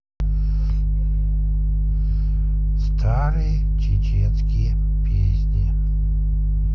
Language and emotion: Russian, neutral